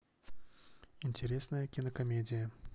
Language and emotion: Russian, neutral